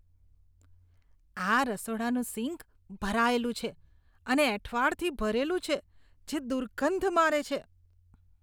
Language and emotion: Gujarati, disgusted